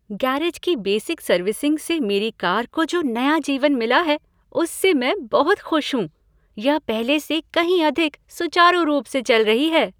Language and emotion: Hindi, happy